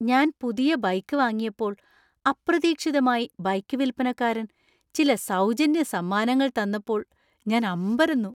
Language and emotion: Malayalam, surprised